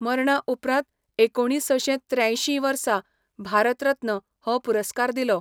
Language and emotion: Goan Konkani, neutral